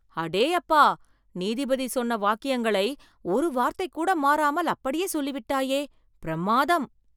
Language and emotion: Tamil, surprised